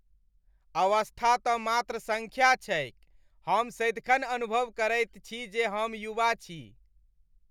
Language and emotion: Maithili, happy